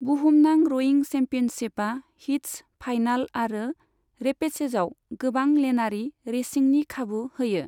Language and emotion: Bodo, neutral